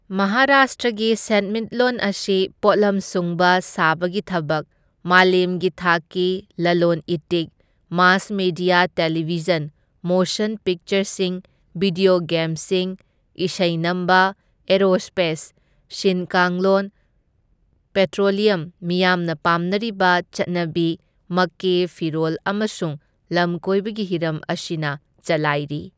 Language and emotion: Manipuri, neutral